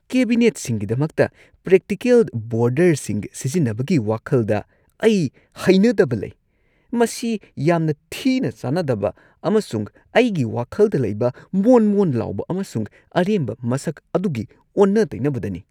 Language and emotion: Manipuri, disgusted